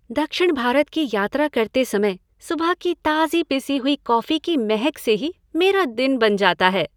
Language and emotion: Hindi, happy